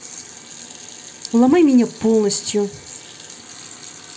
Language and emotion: Russian, neutral